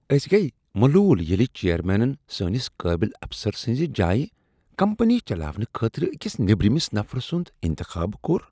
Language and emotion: Kashmiri, disgusted